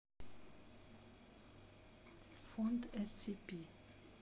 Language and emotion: Russian, neutral